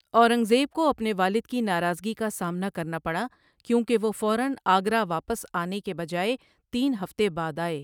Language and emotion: Urdu, neutral